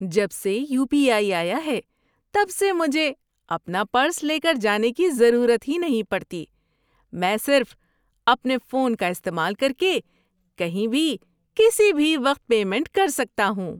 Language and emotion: Urdu, happy